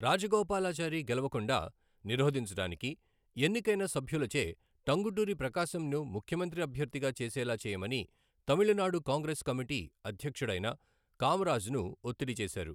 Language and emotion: Telugu, neutral